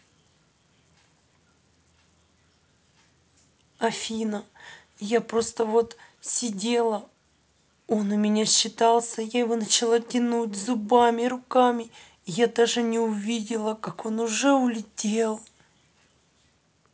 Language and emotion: Russian, sad